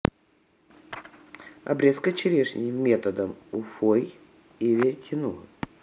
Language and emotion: Russian, neutral